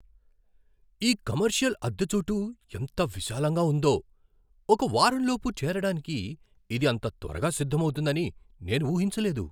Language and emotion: Telugu, surprised